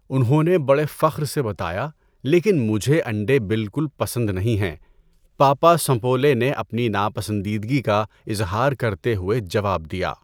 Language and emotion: Urdu, neutral